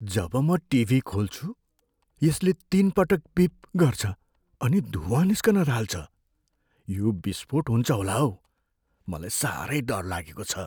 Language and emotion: Nepali, fearful